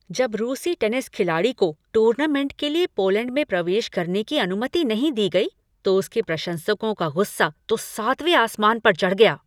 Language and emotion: Hindi, angry